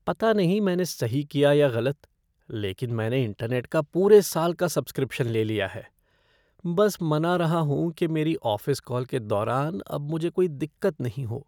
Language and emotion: Hindi, fearful